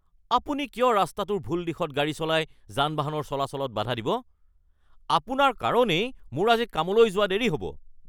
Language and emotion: Assamese, angry